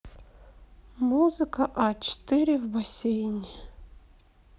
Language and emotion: Russian, neutral